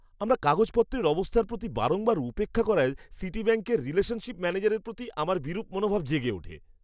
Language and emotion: Bengali, disgusted